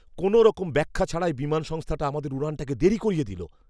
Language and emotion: Bengali, angry